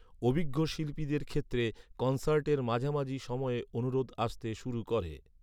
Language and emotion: Bengali, neutral